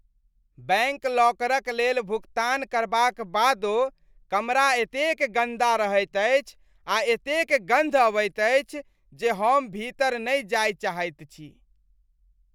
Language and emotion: Maithili, disgusted